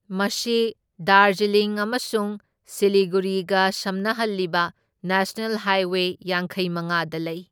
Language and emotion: Manipuri, neutral